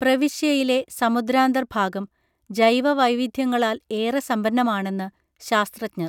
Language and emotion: Malayalam, neutral